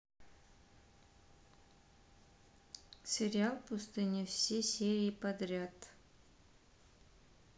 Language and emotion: Russian, neutral